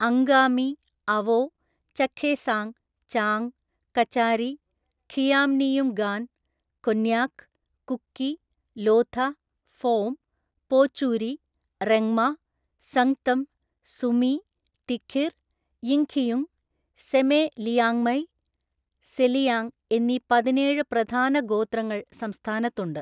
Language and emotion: Malayalam, neutral